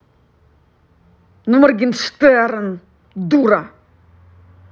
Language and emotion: Russian, angry